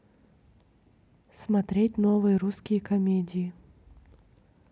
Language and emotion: Russian, neutral